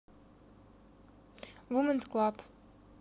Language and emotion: Russian, neutral